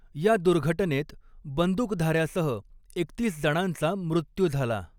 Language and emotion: Marathi, neutral